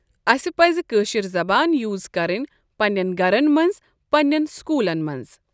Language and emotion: Kashmiri, neutral